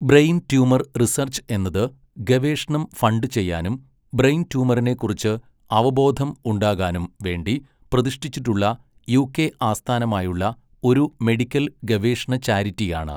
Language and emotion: Malayalam, neutral